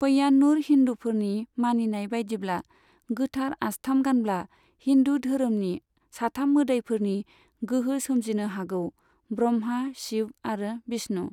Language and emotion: Bodo, neutral